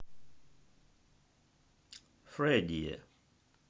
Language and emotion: Russian, neutral